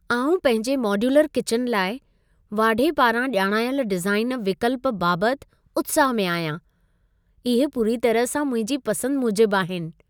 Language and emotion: Sindhi, happy